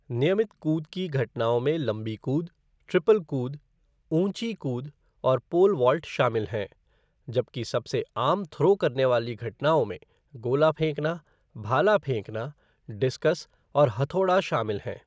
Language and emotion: Hindi, neutral